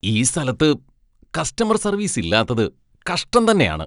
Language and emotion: Malayalam, disgusted